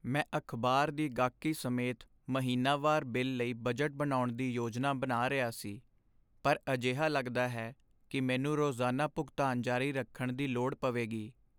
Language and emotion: Punjabi, sad